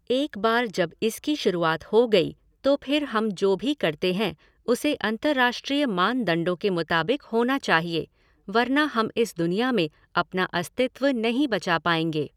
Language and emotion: Hindi, neutral